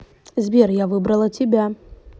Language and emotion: Russian, neutral